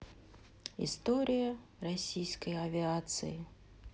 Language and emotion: Russian, sad